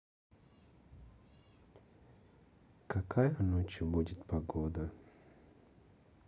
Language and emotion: Russian, sad